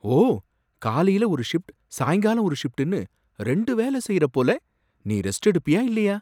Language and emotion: Tamil, surprised